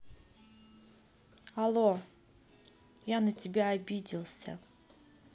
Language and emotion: Russian, sad